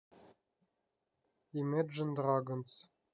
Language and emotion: Russian, neutral